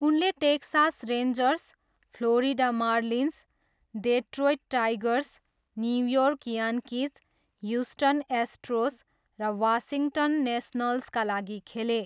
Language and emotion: Nepali, neutral